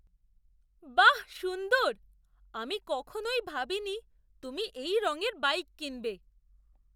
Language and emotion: Bengali, surprised